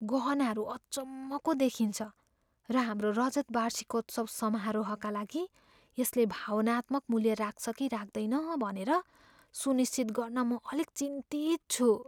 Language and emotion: Nepali, fearful